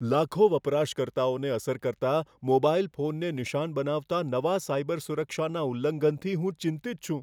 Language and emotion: Gujarati, fearful